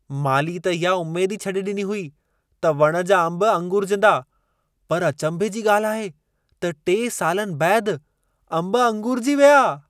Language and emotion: Sindhi, surprised